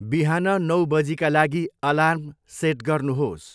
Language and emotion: Nepali, neutral